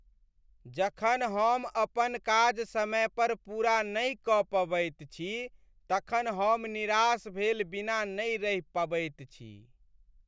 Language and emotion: Maithili, sad